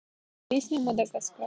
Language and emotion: Russian, neutral